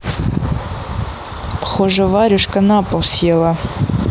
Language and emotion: Russian, neutral